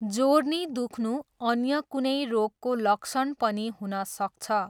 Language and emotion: Nepali, neutral